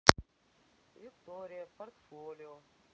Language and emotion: Russian, neutral